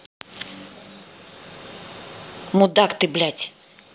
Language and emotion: Russian, angry